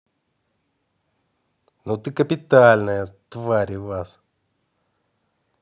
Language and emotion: Russian, angry